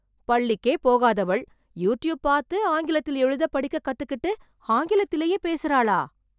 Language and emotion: Tamil, surprised